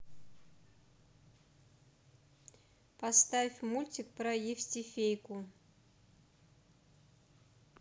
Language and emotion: Russian, neutral